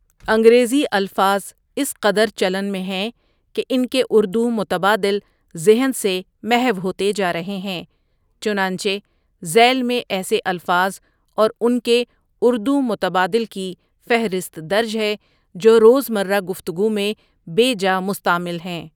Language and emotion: Urdu, neutral